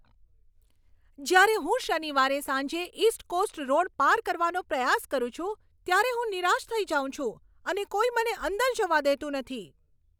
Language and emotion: Gujarati, angry